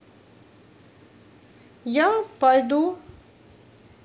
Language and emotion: Russian, neutral